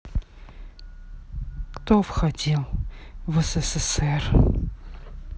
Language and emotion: Russian, neutral